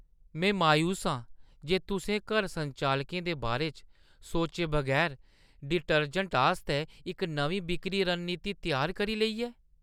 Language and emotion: Dogri, disgusted